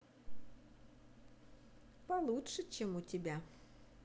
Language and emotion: Russian, positive